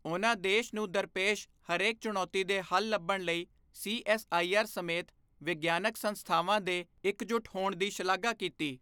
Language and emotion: Punjabi, neutral